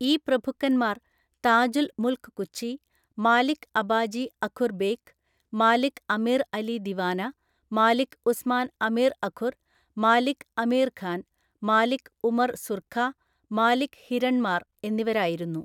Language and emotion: Malayalam, neutral